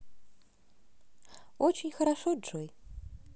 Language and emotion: Russian, positive